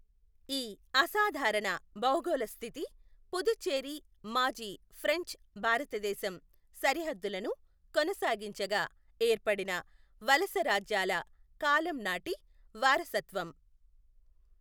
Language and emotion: Telugu, neutral